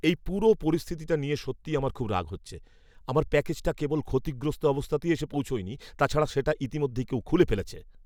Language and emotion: Bengali, angry